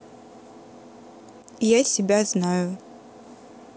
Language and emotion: Russian, neutral